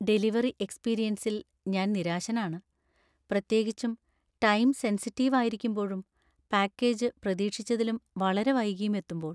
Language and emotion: Malayalam, sad